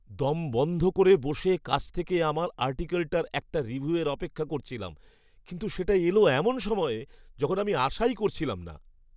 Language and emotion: Bengali, surprised